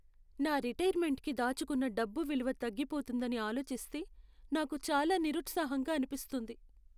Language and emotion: Telugu, sad